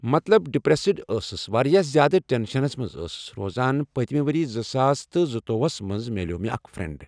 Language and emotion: Kashmiri, neutral